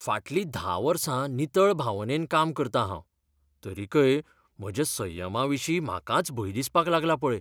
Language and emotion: Goan Konkani, fearful